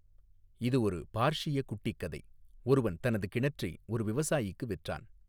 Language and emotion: Tamil, neutral